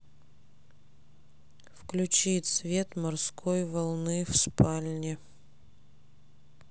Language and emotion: Russian, neutral